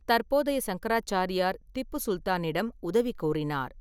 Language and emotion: Tamil, neutral